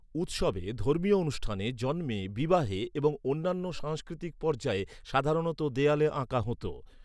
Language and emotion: Bengali, neutral